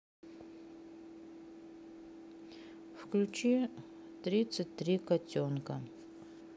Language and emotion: Russian, sad